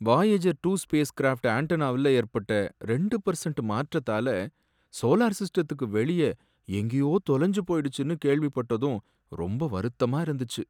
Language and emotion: Tamil, sad